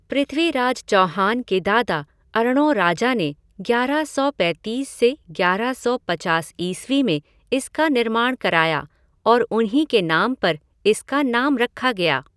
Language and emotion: Hindi, neutral